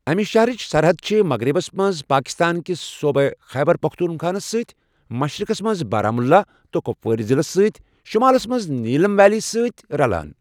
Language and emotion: Kashmiri, neutral